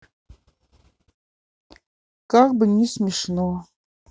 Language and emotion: Russian, sad